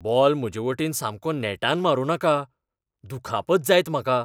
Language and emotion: Goan Konkani, fearful